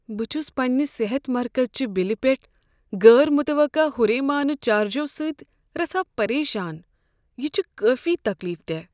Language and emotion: Kashmiri, sad